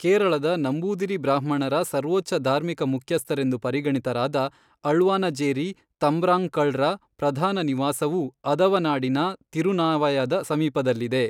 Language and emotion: Kannada, neutral